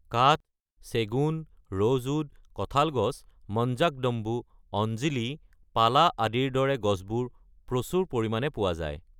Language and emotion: Assamese, neutral